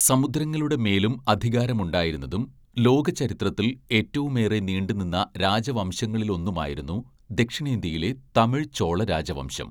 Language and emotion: Malayalam, neutral